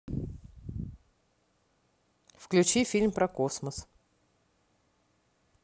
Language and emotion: Russian, neutral